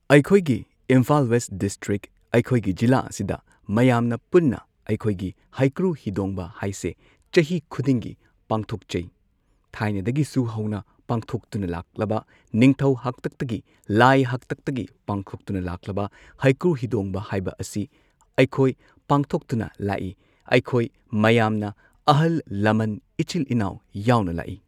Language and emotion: Manipuri, neutral